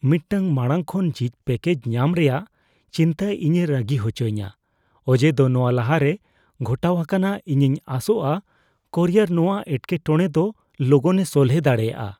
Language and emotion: Santali, fearful